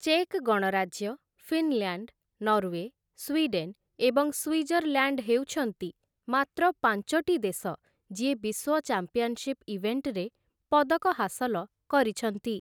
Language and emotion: Odia, neutral